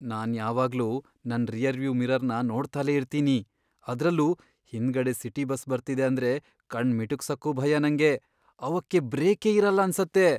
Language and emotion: Kannada, fearful